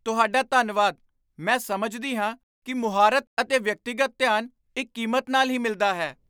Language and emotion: Punjabi, surprised